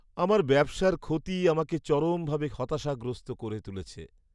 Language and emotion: Bengali, sad